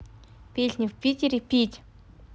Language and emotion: Russian, neutral